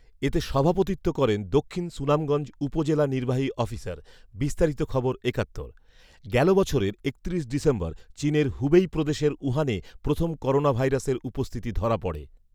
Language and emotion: Bengali, neutral